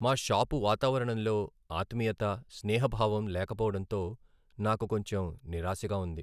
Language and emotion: Telugu, sad